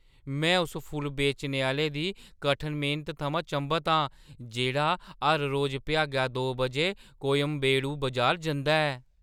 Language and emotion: Dogri, surprised